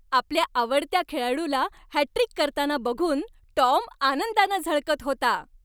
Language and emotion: Marathi, happy